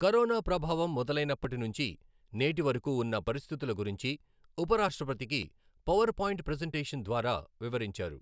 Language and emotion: Telugu, neutral